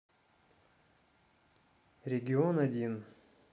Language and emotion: Russian, neutral